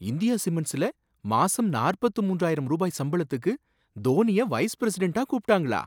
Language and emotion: Tamil, surprised